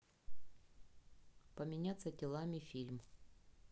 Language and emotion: Russian, neutral